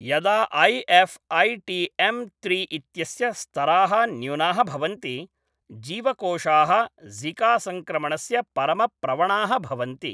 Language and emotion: Sanskrit, neutral